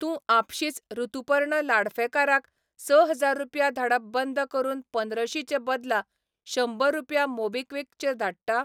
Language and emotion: Goan Konkani, neutral